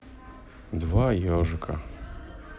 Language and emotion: Russian, neutral